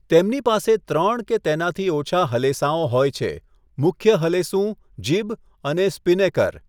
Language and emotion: Gujarati, neutral